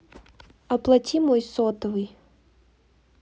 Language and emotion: Russian, neutral